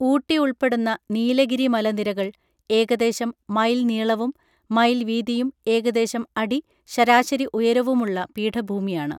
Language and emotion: Malayalam, neutral